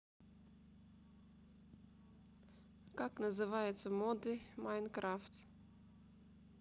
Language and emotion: Russian, neutral